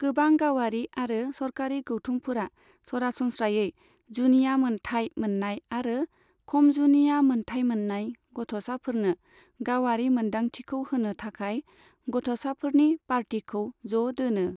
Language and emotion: Bodo, neutral